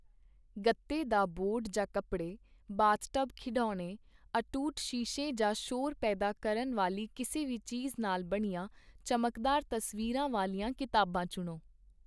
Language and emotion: Punjabi, neutral